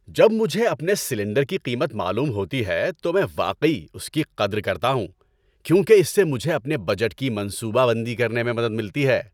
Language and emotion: Urdu, happy